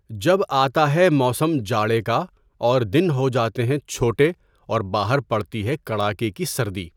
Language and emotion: Urdu, neutral